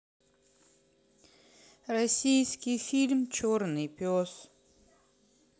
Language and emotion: Russian, sad